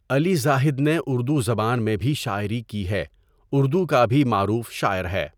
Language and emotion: Urdu, neutral